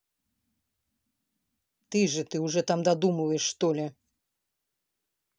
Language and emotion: Russian, angry